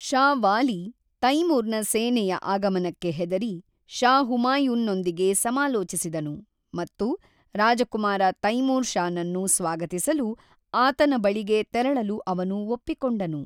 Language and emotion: Kannada, neutral